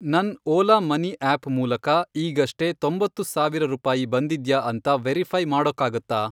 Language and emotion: Kannada, neutral